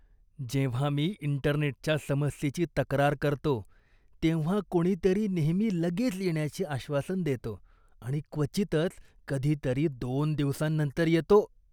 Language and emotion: Marathi, disgusted